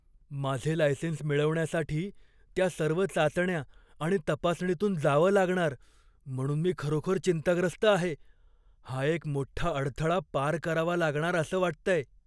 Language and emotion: Marathi, fearful